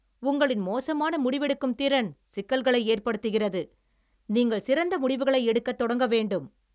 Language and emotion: Tamil, angry